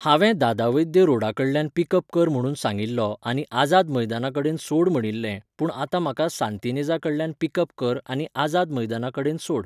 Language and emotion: Goan Konkani, neutral